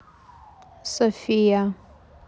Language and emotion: Russian, neutral